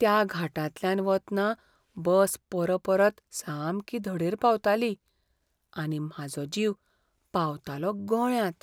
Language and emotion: Goan Konkani, fearful